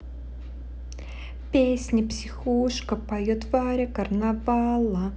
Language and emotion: Russian, positive